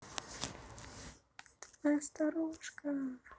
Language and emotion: Russian, positive